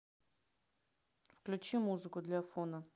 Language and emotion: Russian, neutral